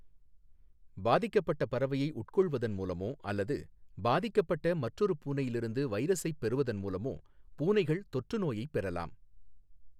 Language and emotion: Tamil, neutral